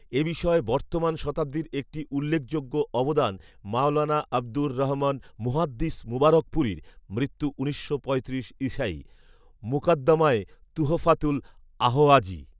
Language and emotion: Bengali, neutral